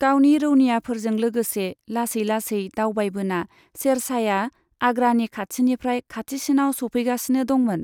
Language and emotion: Bodo, neutral